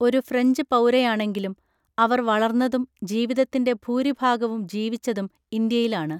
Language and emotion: Malayalam, neutral